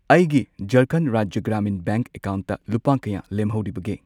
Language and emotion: Manipuri, neutral